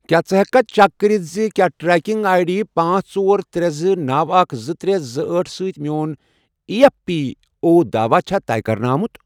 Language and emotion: Kashmiri, neutral